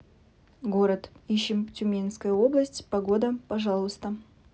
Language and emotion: Russian, neutral